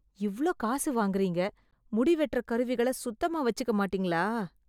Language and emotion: Tamil, disgusted